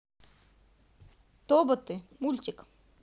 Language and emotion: Russian, positive